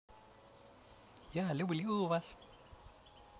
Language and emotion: Russian, positive